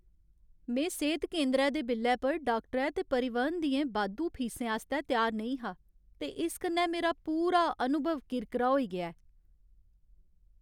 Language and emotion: Dogri, sad